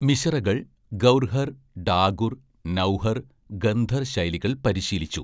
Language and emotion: Malayalam, neutral